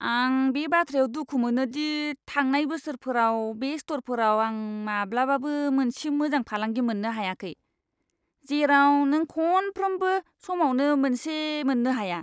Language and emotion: Bodo, disgusted